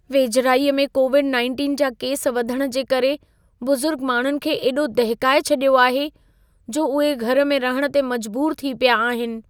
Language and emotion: Sindhi, fearful